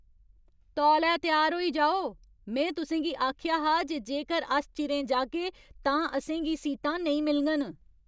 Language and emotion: Dogri, angry